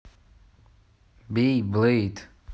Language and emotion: Russian, neutral